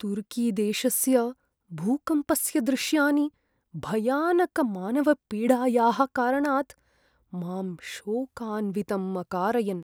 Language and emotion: Sanskrit, sad